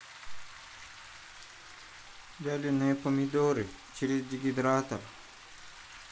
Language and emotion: Russian, neutral